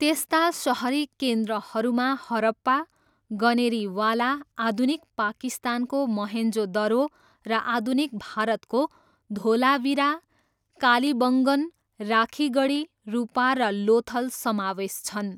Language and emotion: Nepali, neutral